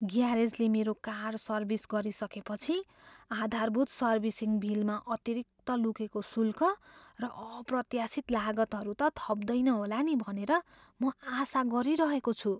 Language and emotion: Nepali, fearful